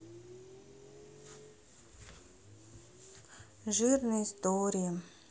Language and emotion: Russian, sad